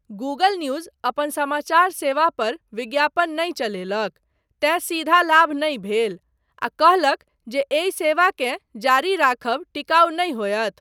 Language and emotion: Maithili, neutral